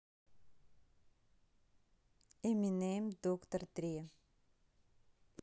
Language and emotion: Russian, neutral